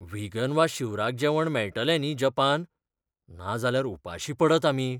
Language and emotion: Goan Konkani, fearful